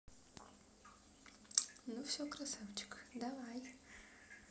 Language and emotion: Russian, positive